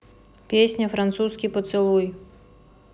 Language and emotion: Russian, neutral